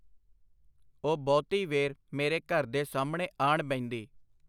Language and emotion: Punjabi, neutral